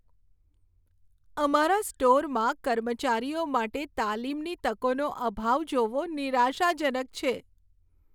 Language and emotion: Gujarati, sad